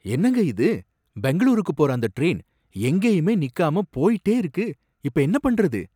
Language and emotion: Tamil, surprised